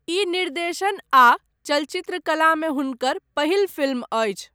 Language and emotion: Maithili, neutral